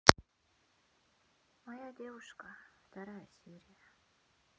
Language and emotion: Russian, sad